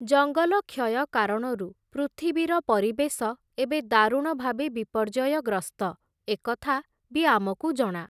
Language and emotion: Odia, neutral